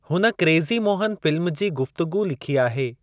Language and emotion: Sindhi, neutral